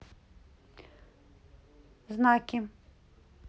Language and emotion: Russian, neutral